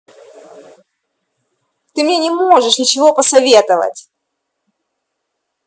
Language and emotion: Russian, angry